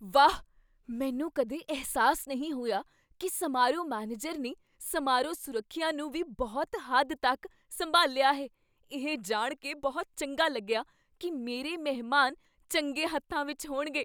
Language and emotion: Punjabi, surprised